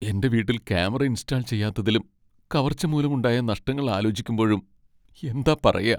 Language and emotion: Malayalam, sad